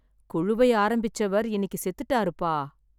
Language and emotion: Tamil, sad